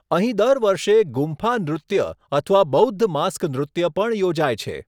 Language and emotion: Gujarati, neutral